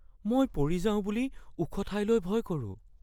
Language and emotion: Assamese, fearful